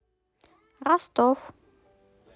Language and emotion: Russian, neutral